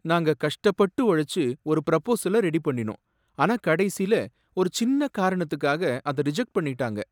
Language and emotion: Tamil, sad